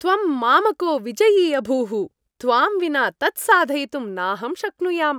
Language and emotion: Sanskrit, happy